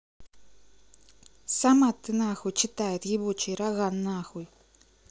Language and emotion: Russian, angry